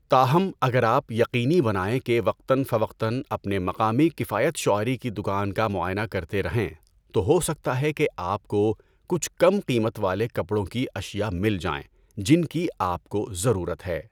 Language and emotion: Urdu, neutral